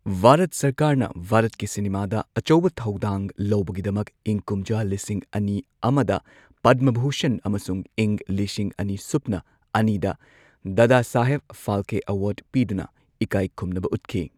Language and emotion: Manipuri, neutral